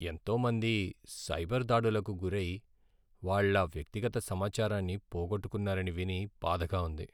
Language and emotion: Telugu, sad